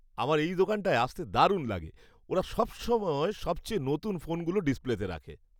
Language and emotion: Bengali, happy